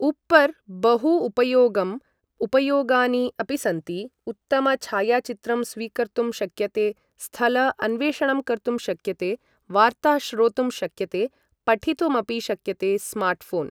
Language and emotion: Sanskrit, neutral